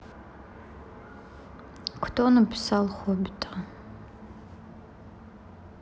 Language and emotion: Russian, neutral